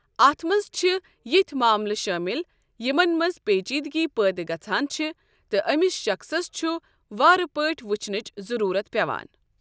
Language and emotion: Kashmiri, neutral